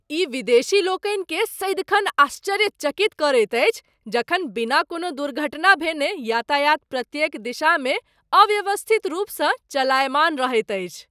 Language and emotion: Maithili, surprised